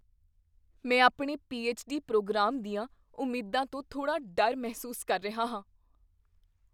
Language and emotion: Punjabi, fearful